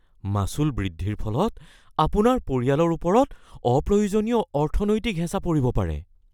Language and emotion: Assamese, fearful